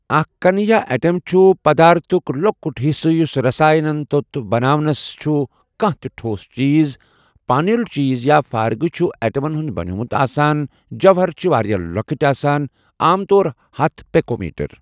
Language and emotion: Kashmiri, neutral